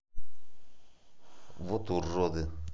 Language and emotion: Russian, angry